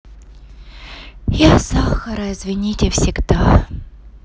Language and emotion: Russian, sad